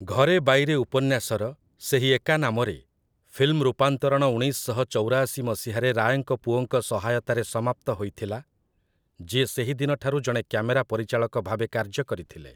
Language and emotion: Odia, neutral